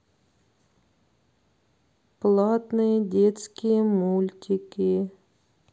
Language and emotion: Russian, sad